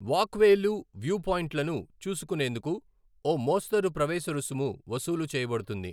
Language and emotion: Telugu, neutral